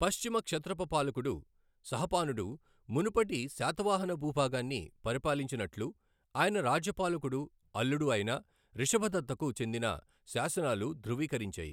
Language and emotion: Telugu, neutral